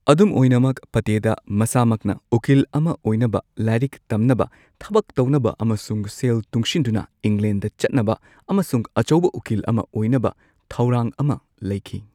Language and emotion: Manipuri, neutral